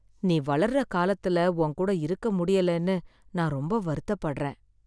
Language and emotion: Tamil, sad